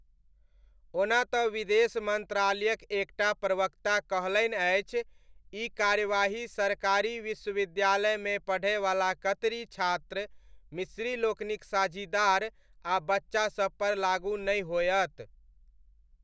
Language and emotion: Maithili, neutral